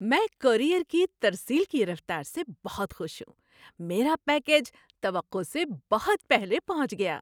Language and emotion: Urdu, happy